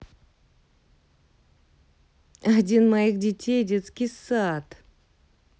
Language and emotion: Russian, neutral